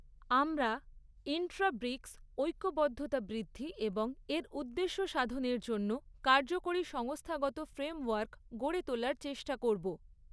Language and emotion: Bengali, neutral